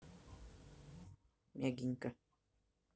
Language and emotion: Russian, neutral